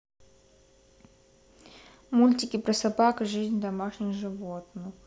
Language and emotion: Russian, neutral